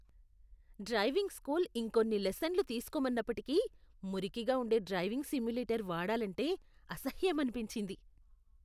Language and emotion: Telugu, disgusted